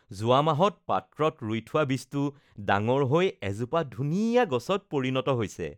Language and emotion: Assamese, happy